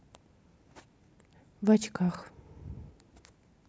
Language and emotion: Russian, neutral